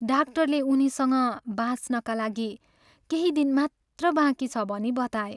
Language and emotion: Nepali, sad